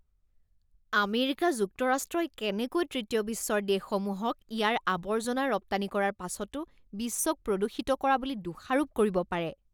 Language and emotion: Assamese, disgusted